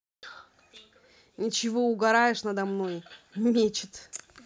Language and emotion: Russian, neutral